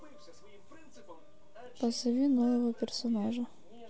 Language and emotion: Russian, neutral